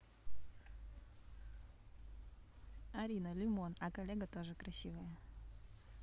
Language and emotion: Russian, neutral